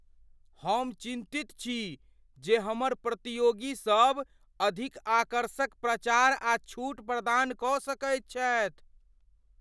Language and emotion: Maithili, fearful